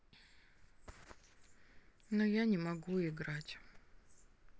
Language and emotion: Russian, sad